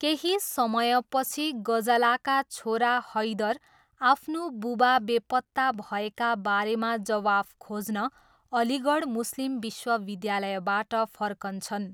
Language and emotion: Nepali, neutral